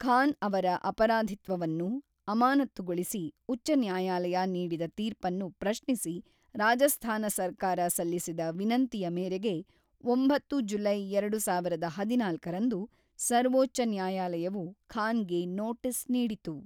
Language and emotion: Kannada, neutral